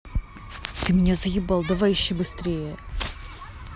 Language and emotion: Russian, angry